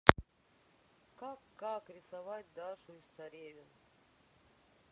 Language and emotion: Russian, neutral